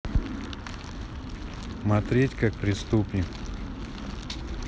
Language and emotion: Russian, neutral